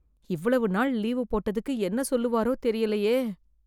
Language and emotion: Tamil, fearful